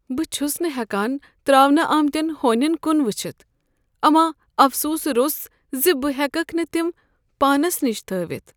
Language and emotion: Kashmiri, sad